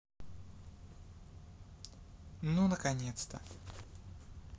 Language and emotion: Russian, neutral